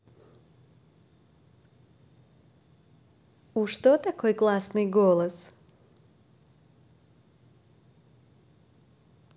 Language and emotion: Russian, positive